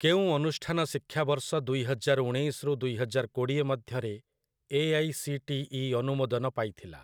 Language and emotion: Odia, neutral